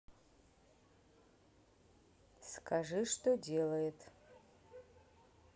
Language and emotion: Russian, neutral